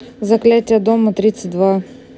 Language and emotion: Russian, neutral